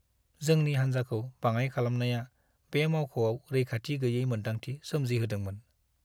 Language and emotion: Bodo, sad